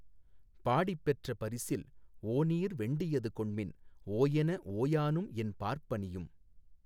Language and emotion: Tamil, neutral